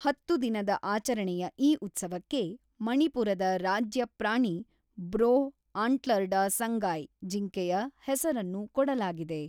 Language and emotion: Kannada, neutral